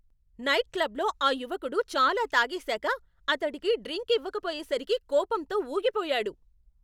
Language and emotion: Telugu, angry